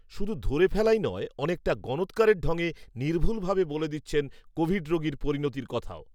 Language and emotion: Bengali, neutral